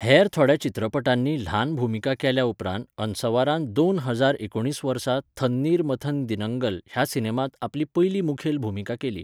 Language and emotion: Goan Konkani, neutral